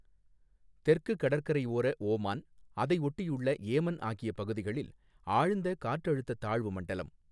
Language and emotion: Tamil, neutral